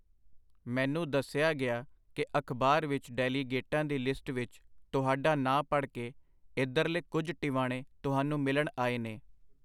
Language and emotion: Punjabi, neutral